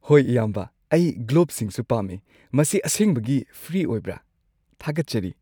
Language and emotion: Manipuri, happy